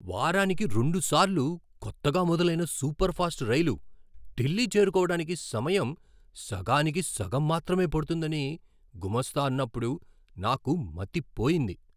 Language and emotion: Telugu, surprised